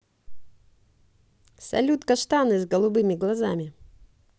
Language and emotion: Russian, positive